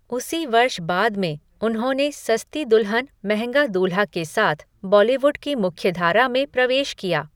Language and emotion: Hindi, neutral